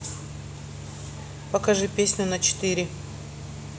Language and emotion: Russian, neutral